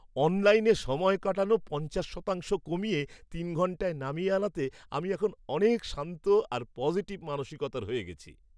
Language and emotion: Bengali, happy